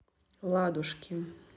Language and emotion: Russian, neutral